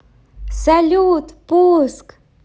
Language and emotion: Russian, positive